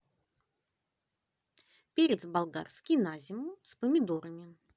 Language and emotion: Russian, positive